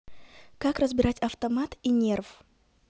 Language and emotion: Russian, neutral